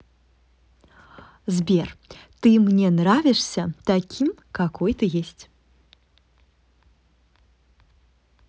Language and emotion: Russian, positive